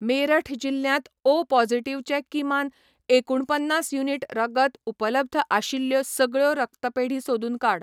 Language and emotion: Goan Konkani, neutral